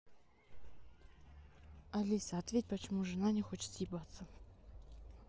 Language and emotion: Russian, neutral